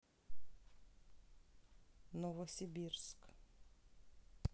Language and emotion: Russian, neutral